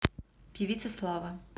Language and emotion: Russian, neutral